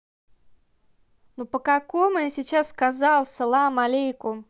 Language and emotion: Russian, angry